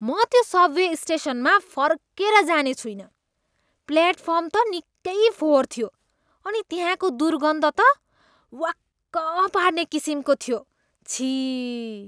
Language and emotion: Nepali, disgusted